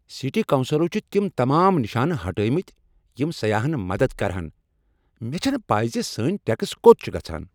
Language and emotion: Kashmiri, angry